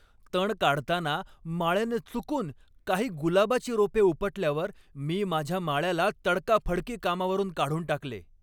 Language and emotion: Marathi, angry